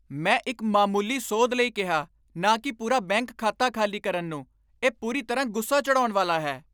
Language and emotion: Punjabi, angry